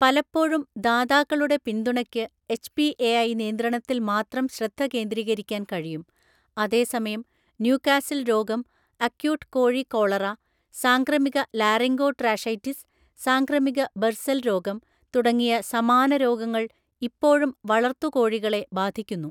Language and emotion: Malayalam, neutral